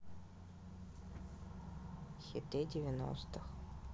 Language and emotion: Russian, neutral